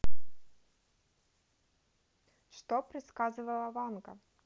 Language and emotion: Russian, neutral